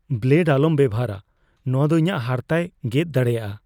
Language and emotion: Santali, fearful